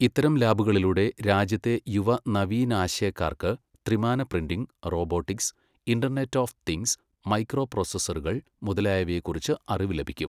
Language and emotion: Malayalam, neutral